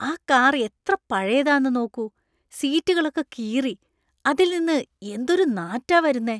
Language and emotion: Malayalam, disgusted